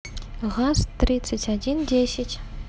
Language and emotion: Russian, neutral